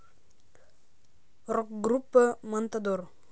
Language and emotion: Russian, neutral